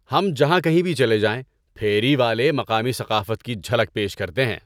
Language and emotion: Urdu, happy